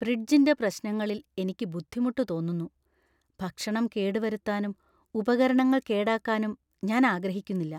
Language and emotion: Malayalam, fearful